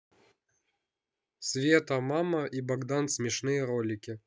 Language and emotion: Russian, neutral